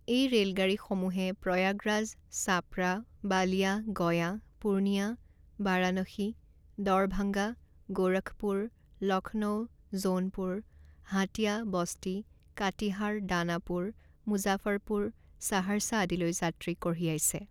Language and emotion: Assamese, neutral